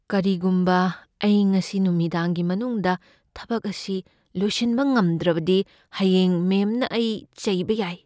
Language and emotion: Manipuri, fearful